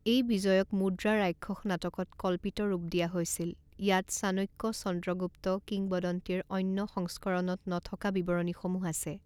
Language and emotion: Assamese, neutral